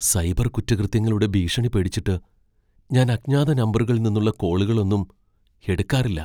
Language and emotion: Malayalam, fearful